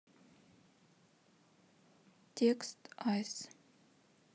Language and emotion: Russian, sad